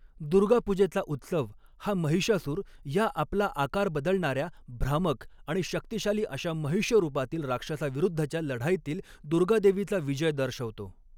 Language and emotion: Marathi, neutral